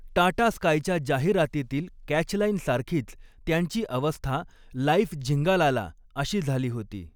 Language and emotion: Marathi, neutral